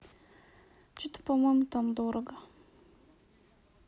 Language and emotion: Russian, neutral